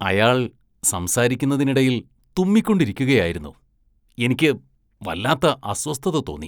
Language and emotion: Malayalam, disgusted